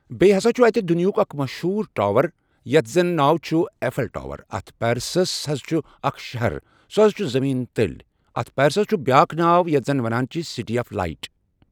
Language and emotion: Kashmiri, neutral